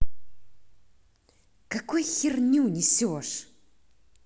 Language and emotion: Russian, angry